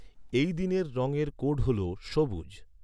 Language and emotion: Bengali, neutral